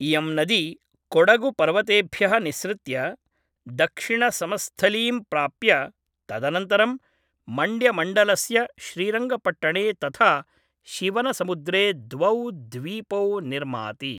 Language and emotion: Sanskrit, neutral